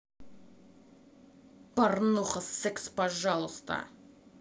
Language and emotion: Russian, angry